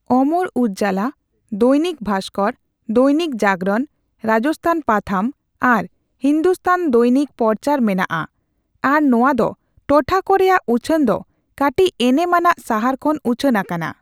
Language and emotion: Santali, neutral